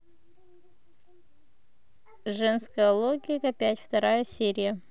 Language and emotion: Russian, neutral